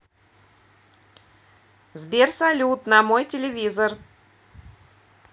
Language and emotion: Russian, positive